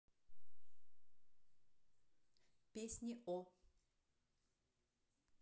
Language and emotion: Russian, neutral